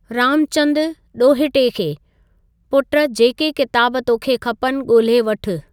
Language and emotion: Sindhi, neutral